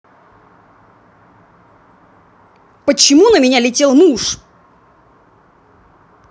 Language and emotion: Russian, angry